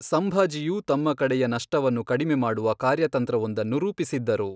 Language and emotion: Kannada, neutral